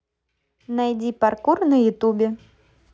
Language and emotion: Russian, positive